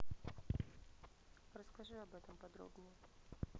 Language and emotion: Russian, neutral